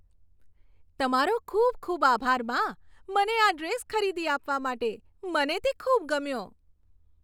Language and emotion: Gujarati, happy